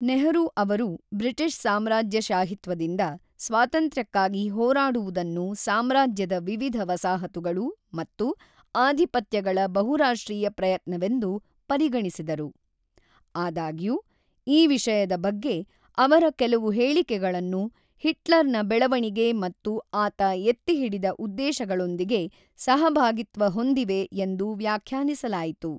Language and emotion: Kannada, neutral